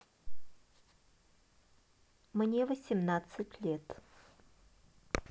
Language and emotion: Russian, neutral